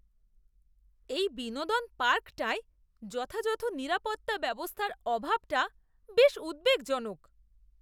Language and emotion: Bengali, disgusted